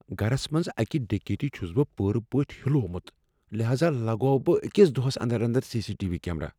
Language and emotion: Kashmiri, fearful